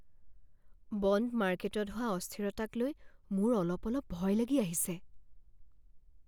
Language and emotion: Assamese, fearful